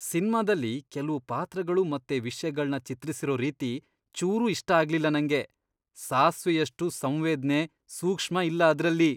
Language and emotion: Kannada, disgusted